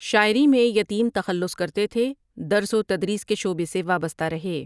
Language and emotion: Urdu, neutral